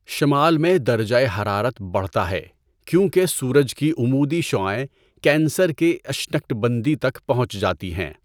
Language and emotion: Urdu, neutral